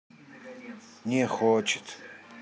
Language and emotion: Russian, sad